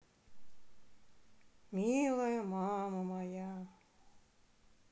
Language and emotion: Russian, sad